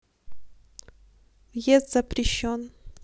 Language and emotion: Russian, neutral